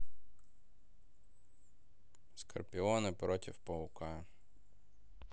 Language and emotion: Russian, neutral